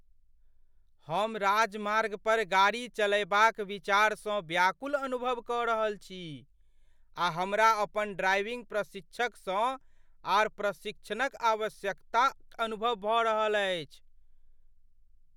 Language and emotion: Maithili, fearful